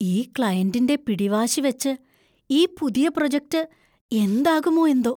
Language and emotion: Malayalam, fearful